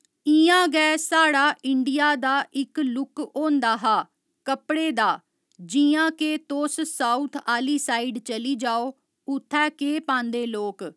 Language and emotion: Dogri, neutral